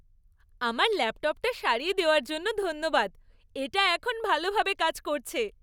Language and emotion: Bengali, happy